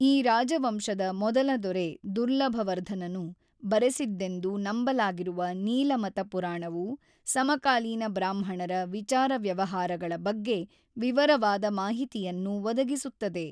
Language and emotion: Kannada, neutral